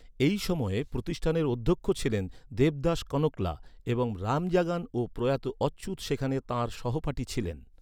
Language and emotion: Bengali, neutral